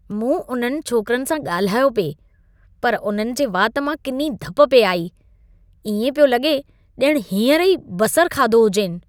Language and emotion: Sindhi, disgusted